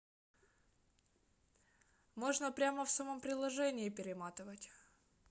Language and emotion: Russian, neutral